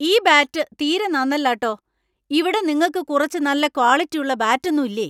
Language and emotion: Malayalam, angry